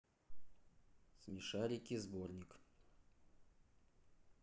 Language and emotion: Russian, neutral